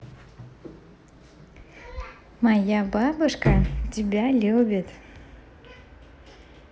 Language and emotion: Russian, positive